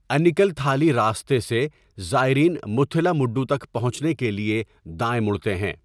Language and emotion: Urdu, neutral